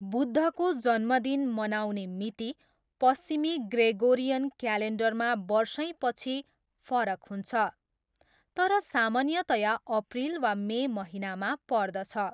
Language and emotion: Nepali, neutral